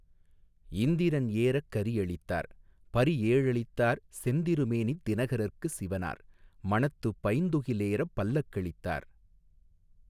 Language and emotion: Tamil, neutral